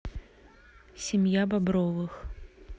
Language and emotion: Russian, neutral